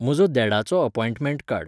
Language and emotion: Goan Konkani, neutral